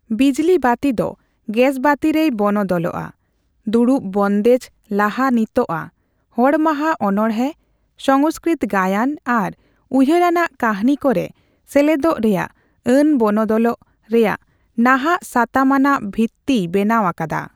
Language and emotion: Santali, neutral